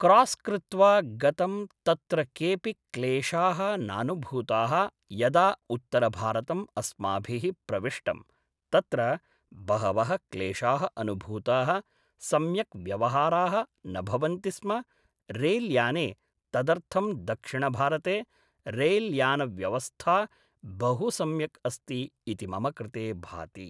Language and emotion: Sanskrit, neutral